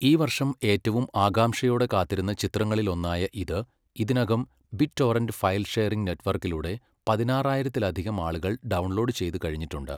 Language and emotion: Malayalam, neutral